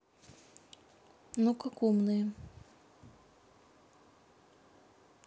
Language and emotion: Russian, neutral